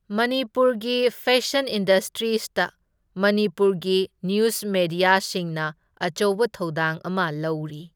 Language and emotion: Manipuri, neutral